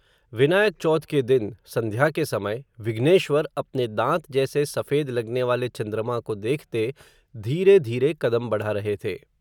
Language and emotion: Hindi, neutral